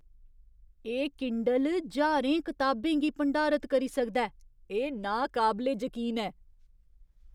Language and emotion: Dogri, surprised